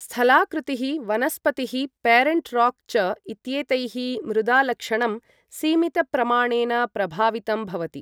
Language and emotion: Sanskrit, neutral